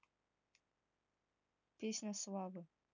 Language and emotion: Russian, neutral